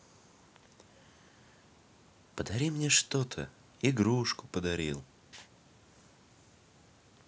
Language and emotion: Russian, neutral